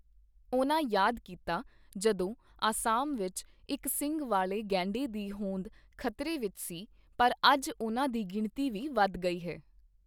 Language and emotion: Punjabi, neutral